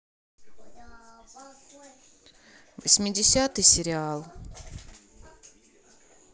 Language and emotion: Russian, neutral